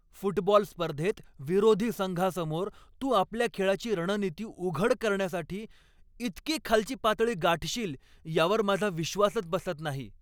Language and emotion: Marathi, angry